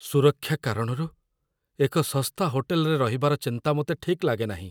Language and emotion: Odia, fearful